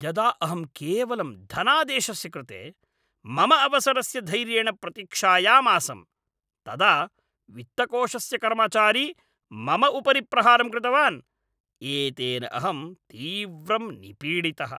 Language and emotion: Sanskrit, angry